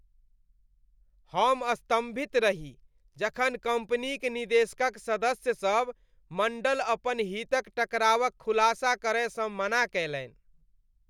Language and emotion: Maithili, disgusted